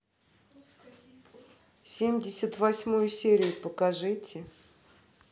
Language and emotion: Russian, neutral